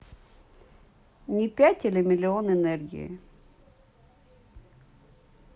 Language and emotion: Russian, neutral